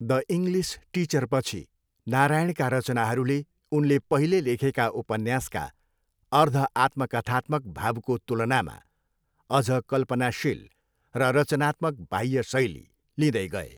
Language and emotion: Nepali, neutral